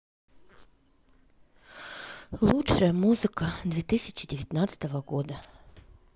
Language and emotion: Russian, sad